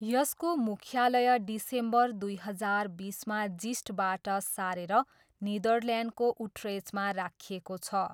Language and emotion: Nepali, neutral